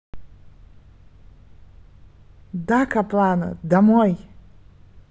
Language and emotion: Russian, neutral